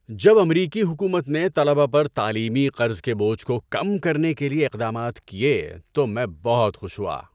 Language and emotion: Urdu, happy